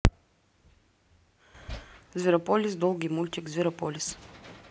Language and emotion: Russian, neutral